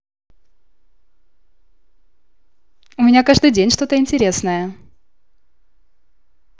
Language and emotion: Russian, positive